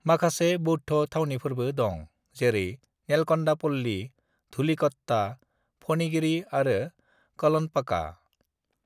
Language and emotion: Bodo, neutral